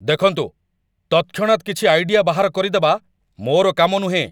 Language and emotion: Odia, angry